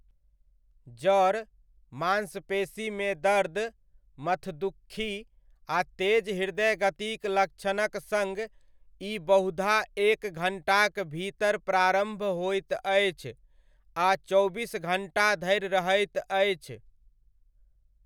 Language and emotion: Maithili, neutral